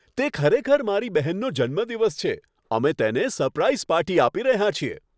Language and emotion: Gujarati, happy